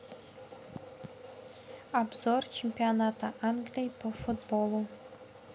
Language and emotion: Russian, neutral